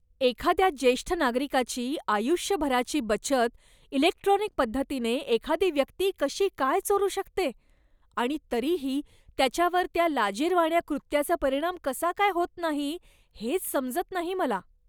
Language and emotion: Marathi, disgusted